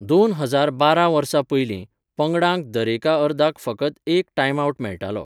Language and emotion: Goan Konkani, neutral